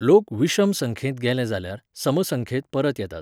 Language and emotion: Goan Konkani, neutral